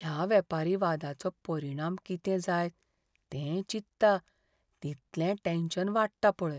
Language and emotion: Goan Konkani, fearful